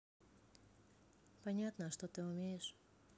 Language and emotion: Russian, neutral